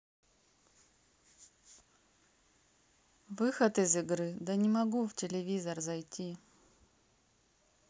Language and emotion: Russian, neutral